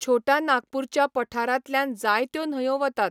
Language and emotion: Goan Konkani, neutral